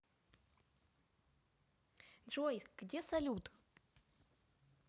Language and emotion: Russian, neutral